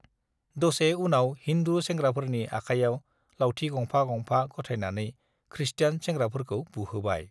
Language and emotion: Bodo, neutral